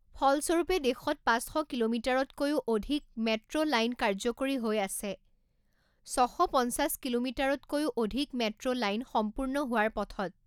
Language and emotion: Assamese, neutral